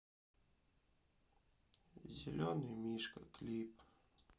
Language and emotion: Russian, sad